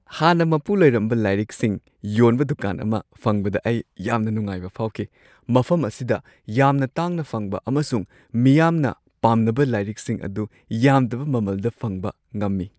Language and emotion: Manipuri, happy